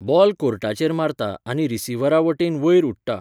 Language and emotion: Goan Konkani, neutral